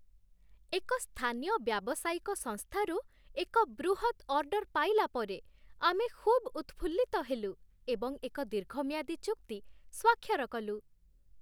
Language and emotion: Odia, happy